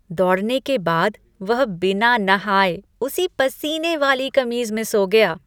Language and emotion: Hindi, disgusted